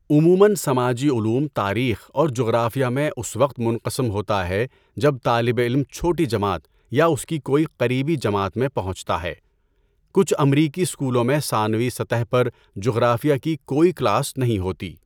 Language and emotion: Urdu, neutral